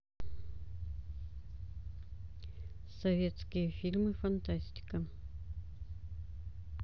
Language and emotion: Russian, neutral